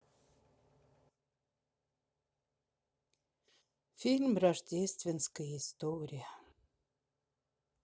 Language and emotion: Russian, sad